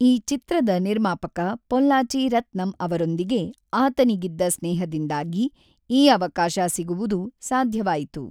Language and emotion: Kannada, neutral